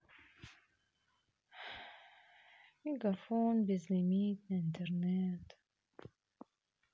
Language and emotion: Russian, sad